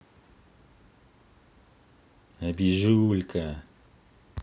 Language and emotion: Russian, positive